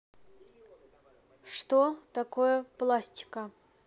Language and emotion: Russian, neutral